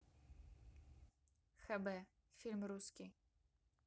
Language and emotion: Russian, neutral